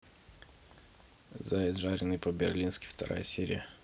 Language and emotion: Russian, neutral